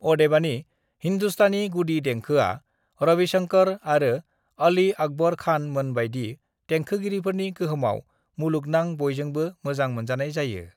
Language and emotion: Bodo, neutral